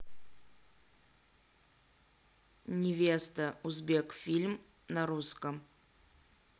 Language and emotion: Russian, neutral